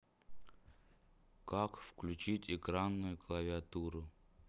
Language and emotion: Russian, sad